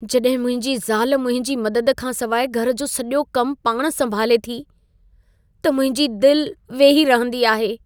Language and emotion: Sindhi, sad